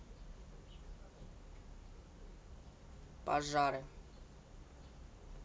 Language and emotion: Russian, neutral